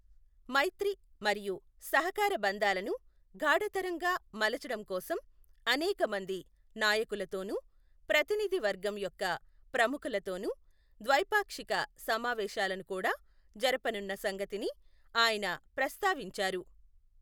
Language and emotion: Telugu, neutral